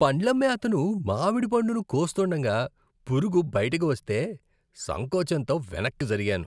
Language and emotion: Telugu, disgusted